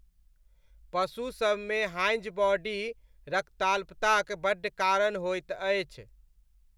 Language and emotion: Maithili, neutral